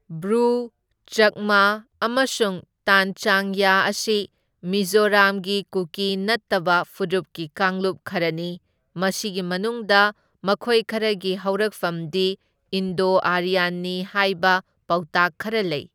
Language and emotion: Manipuri, neutral